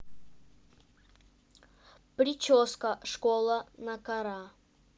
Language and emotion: Russian, neutral